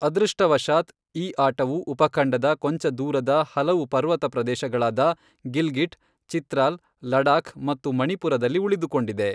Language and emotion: Kannada, neutral